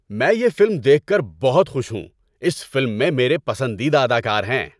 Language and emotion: Urdu, happy